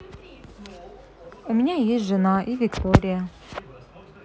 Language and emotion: Russian, neutral